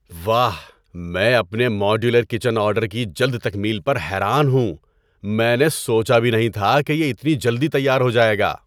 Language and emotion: Urdu, surprised